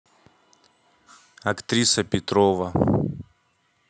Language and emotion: Russian, neutral